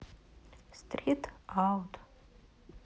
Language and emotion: Russian, sad